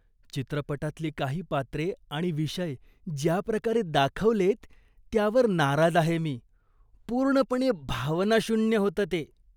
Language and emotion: Marathi, disgusted